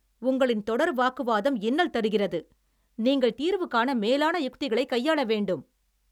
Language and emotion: Tamil, angry